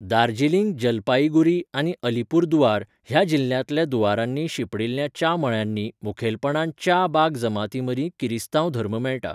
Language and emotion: Goan Konkani, neutral